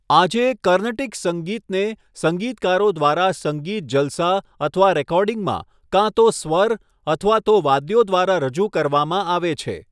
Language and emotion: Gujarati, neutral